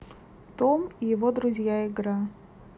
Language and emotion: Russian, neutral